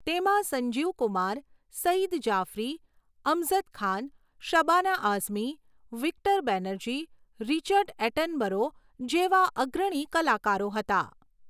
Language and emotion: Gujarati, neutral